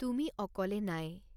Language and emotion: Assamese, neutral